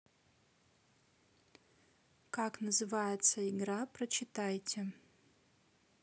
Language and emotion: Russian, neutral